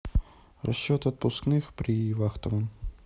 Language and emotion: Russian, neutral